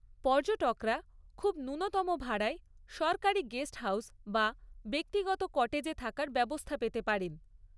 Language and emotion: Bengali, neutral